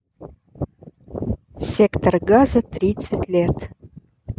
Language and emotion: Russian, neutral